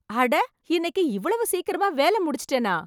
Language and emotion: Tamil, surprised